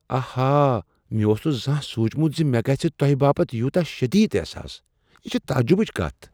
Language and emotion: Kashmiri, surprised